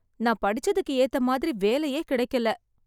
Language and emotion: Tamil, sad